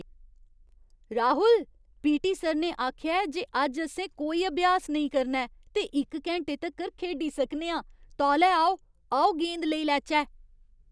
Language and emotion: Dogri, surprised